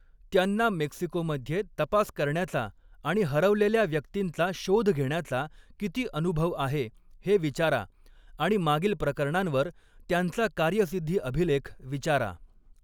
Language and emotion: Marathi, neutral